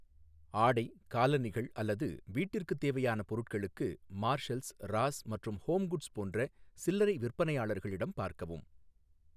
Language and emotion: Tamil, neutral